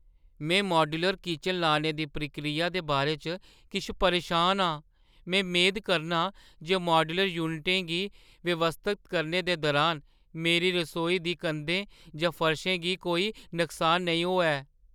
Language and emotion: Dogri, fearful